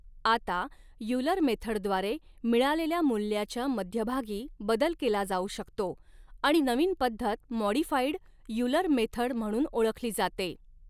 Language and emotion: Marathi, neutral